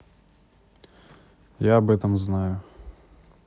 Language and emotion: Russian, neutral